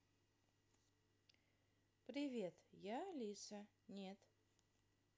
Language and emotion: Russian, positive